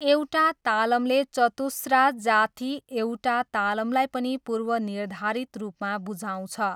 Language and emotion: Nepali, neutral